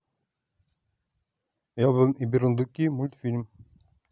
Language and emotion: Russian, neutral